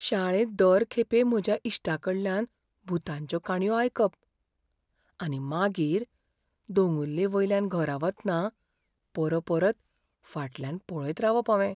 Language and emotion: Goan Konkani, fearful